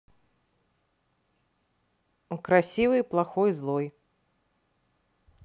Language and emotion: Russian, neutral